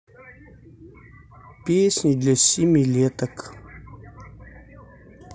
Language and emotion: Russian, neutral